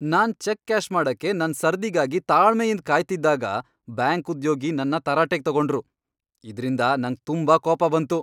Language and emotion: Kannada, angry